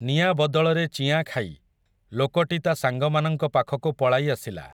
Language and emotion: Odia, neutral